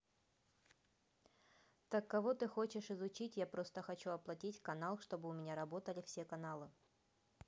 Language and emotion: Russian, neutral